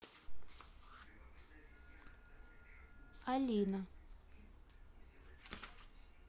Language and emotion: Russian, neutral